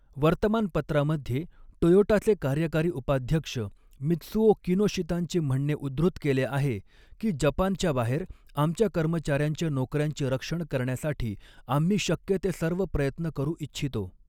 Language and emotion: Marathi, neutral